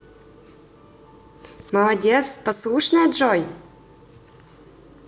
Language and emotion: Russian, positive